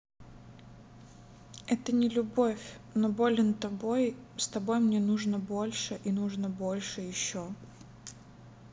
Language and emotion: Russian, neutral